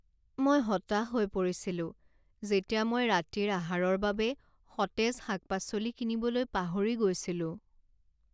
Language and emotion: Assamese, sad